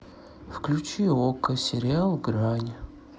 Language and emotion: Russian, sad